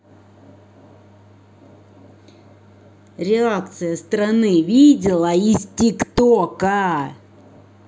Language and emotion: Russian, angry